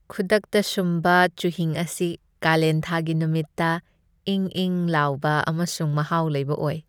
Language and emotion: Manipuri, happy